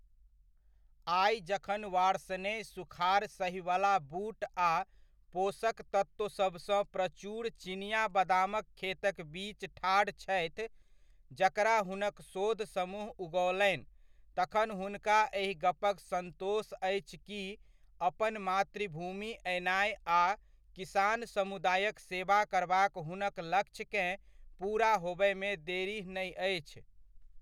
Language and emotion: Maithili, neutral